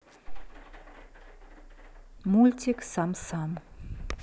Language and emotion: Russian, neutral